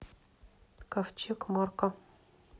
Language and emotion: Russian, neutral